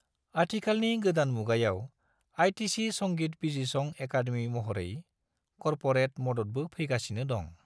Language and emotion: Bodo, neutral